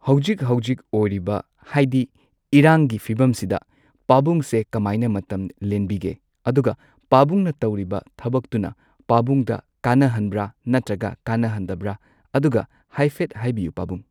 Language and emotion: Manipuri, neutral